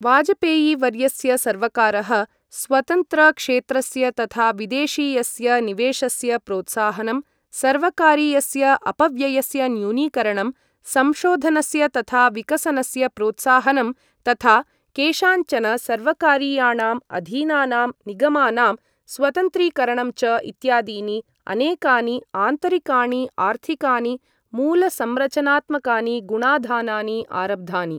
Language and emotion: Sanskrit, neutral